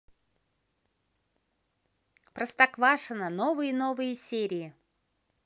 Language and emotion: Russian, positive